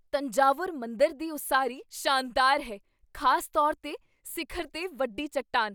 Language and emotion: Punjabi, surprised